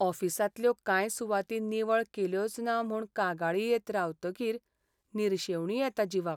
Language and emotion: Goan Konkani, sad